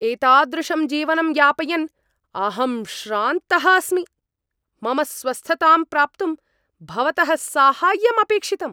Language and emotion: Sanskrit, angry